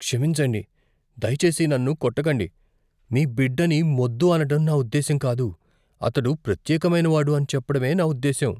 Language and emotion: Telugu, fearful